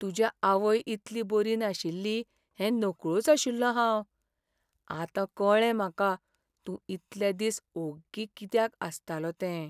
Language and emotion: Goan Konkani, sad